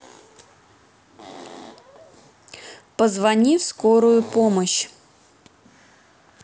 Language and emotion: Russian, neutral